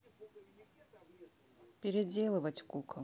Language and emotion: Russian, neutral